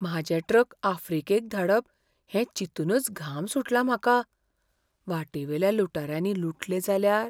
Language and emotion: Goan Konkani, fearful